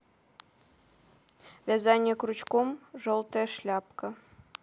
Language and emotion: Russian, neutral